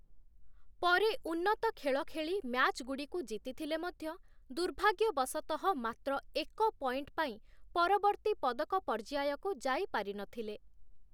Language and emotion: Odia, neutral